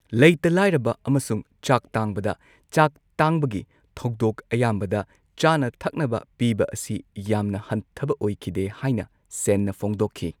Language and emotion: Manipuri, neutral